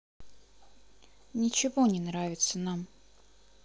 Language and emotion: Russian, sad